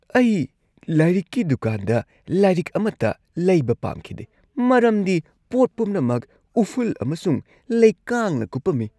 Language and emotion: Manipuri, disgusted